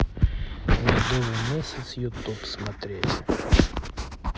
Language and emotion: Russian, neutral